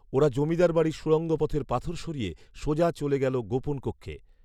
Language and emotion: Bengali, neutral